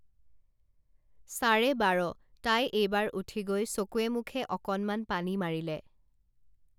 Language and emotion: Assamese, neutral